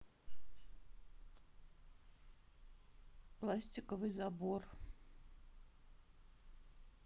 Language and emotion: Russian, neutral